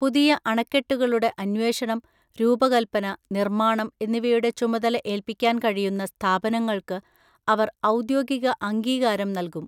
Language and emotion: Malayalam, neutral